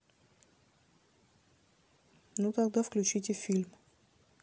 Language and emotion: Russian, neutral